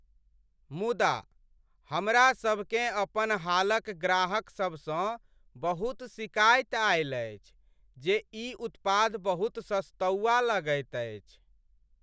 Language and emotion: Maithili, sad